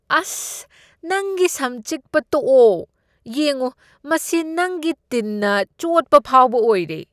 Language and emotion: Manipuri, disgusted